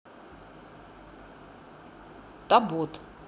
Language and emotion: Russian, neutral